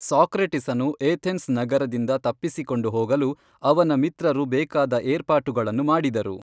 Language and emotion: Kannada, neutral